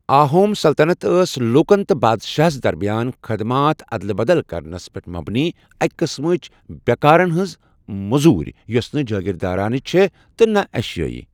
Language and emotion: Kashmiri, neutral